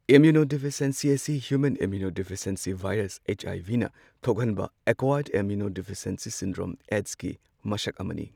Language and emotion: Manipuri, neutral